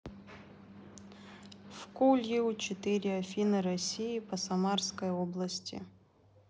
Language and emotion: Russian, neutral